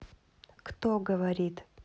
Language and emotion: Russian, neutral